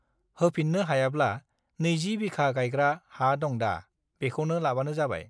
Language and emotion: Bodo, neutral